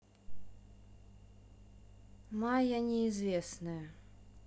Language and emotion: Russian, neutral